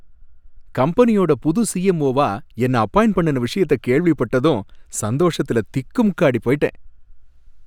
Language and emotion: Tamil, happy